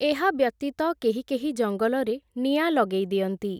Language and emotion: Odia, neutral